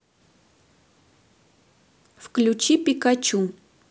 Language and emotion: Russian, neutral